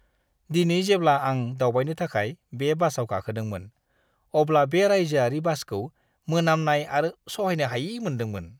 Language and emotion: Bodo, disgusted